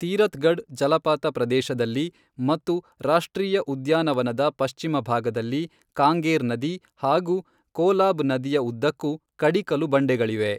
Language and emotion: Kannada, neutral